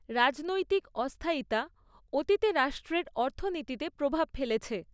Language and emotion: Bengali, neutral